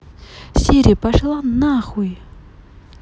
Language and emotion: Russian, angry